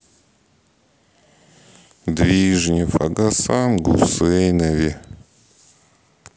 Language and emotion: Russian, sad